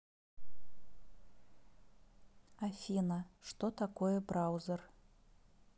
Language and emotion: Russian, neutral